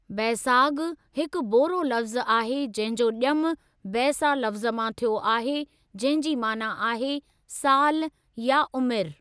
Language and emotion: Sindhi, neutral